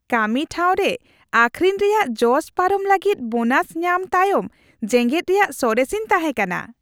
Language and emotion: Santali, happy